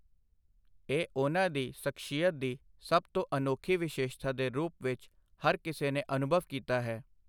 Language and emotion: Punjabi, neutral